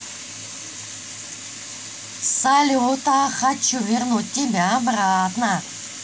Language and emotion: Russian, positive